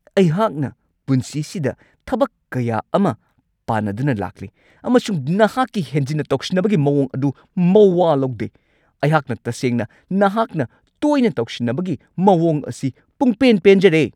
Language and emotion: Manipuri, angry